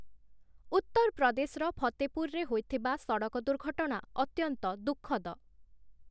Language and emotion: Odia, neutral